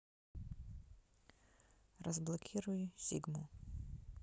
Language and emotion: Russian, neutral